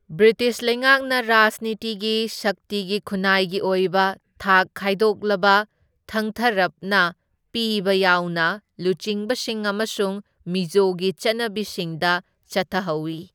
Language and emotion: Manipuri, neutral